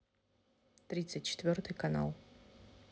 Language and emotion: Russian, neutral